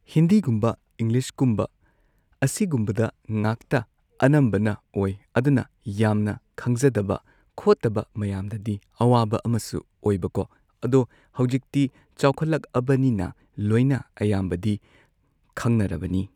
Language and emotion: Manipuri, neutral